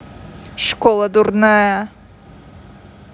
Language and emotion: Russian, angry